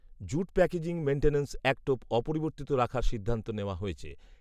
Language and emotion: Bengali, neutral